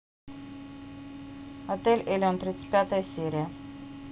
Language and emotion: Russian, neutral